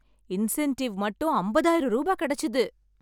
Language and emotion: Tamil, happy